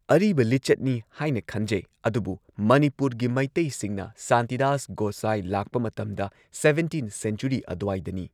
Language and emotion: Manipuri, neutral